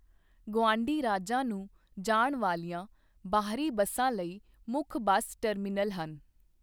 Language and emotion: Punjabi, neutral